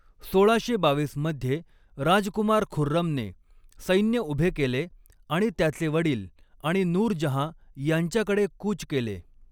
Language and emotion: Marathi, neutral